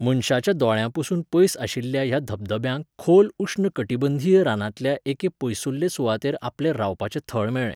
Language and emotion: Goan Konkani, neutral